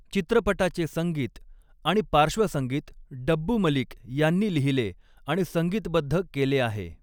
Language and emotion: Marathi, neutral